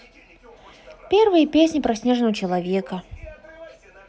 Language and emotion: Russian, positive